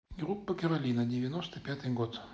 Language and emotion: Russian, neutral